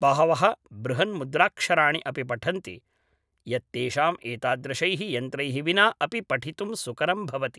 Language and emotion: Sanskrit, neutral